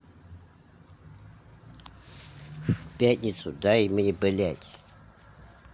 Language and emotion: Russian, angry